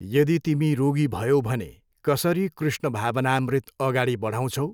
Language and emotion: Nepali, neutral